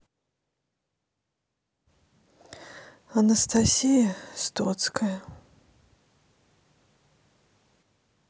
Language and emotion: Russian, sad